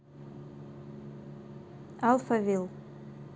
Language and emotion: Russian, neutral